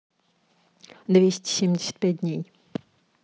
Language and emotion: Russian, neutral